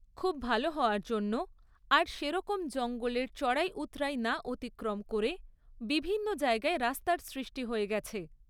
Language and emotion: Bengali, neutral